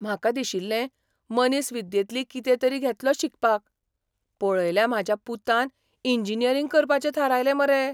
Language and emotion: Goan Konkani, surprised